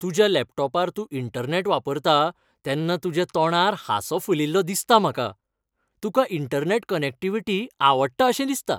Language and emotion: Goan Konkani, happy